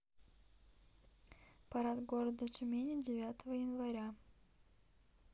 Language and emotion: Russian, neutral